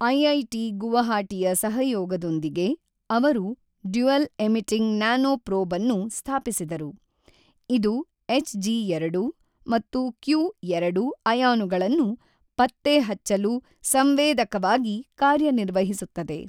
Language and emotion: Kannada, neutral